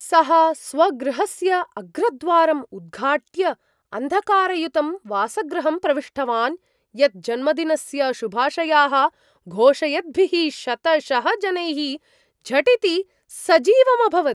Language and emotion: Sanskrit, surprised